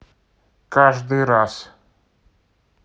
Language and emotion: Russian, neutral